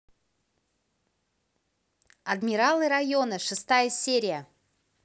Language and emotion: Russian, positive